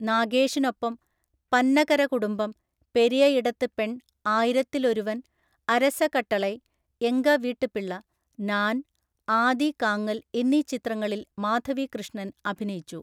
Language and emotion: Malayalam, neutral